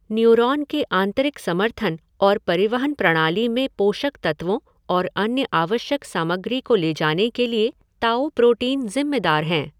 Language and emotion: Hindi, neutral